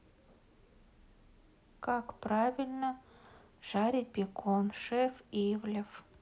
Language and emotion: Russian, neutral